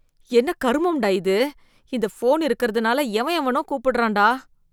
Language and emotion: Tamil, disgusted